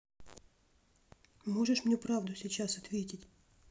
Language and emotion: Russian, neutral